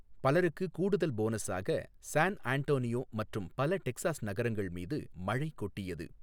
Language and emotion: Tamil, neutral